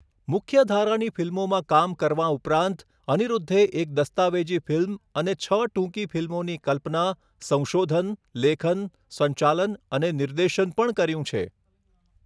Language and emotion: Gujarati, neutral